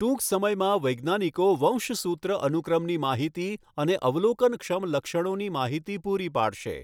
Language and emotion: Gujarati, neutral